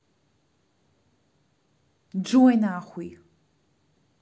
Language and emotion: Russian, angry